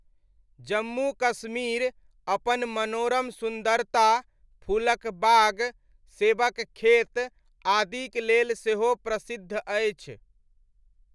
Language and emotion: Maithili, neutral